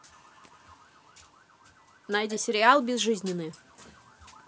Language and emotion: Russian, neutral